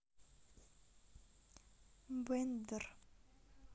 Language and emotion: Russian, sad